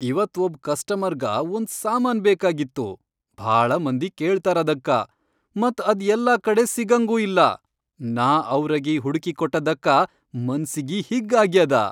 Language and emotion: Kannada, happy